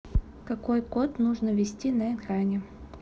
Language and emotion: Russian, neutral